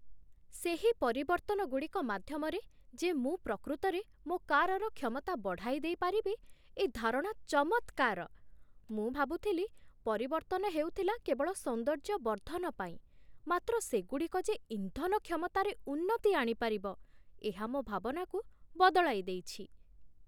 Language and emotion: Odia, surprised